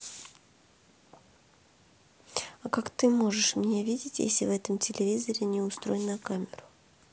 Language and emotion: Russian, neutral